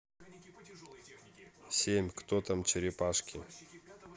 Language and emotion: Russian, neutral